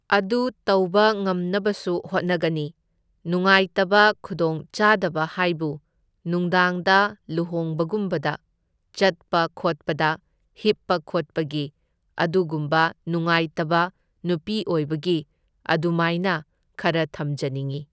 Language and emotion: Manipuri, neutral